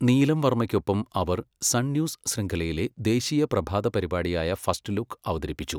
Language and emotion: Malayalam, neutral